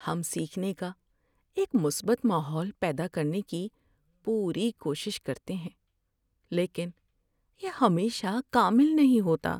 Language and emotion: Urdu, sad